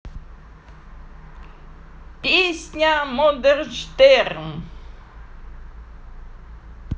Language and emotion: Russian, positive